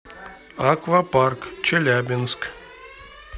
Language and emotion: Russian, neutral